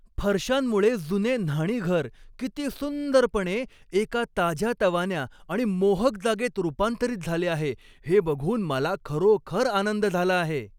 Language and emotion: Marathi, happy